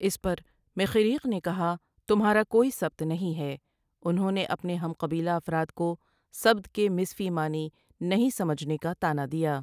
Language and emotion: Urdu, neutral